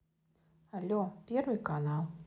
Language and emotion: Russian, neutral